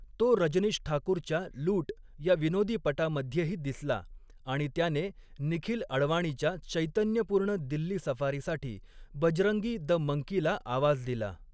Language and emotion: Marathi, neutral